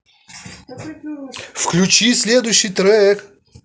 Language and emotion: Russian, angry